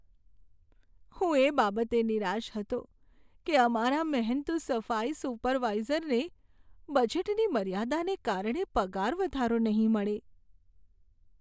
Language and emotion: Gujarati, sad